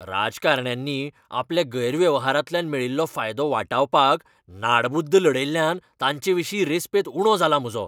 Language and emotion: Goan Konkani, angry